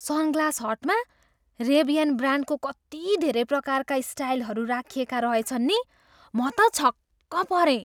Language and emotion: Nepali, surprised